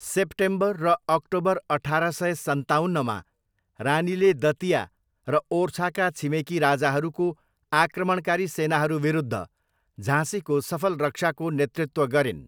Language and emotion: Nepali, neutral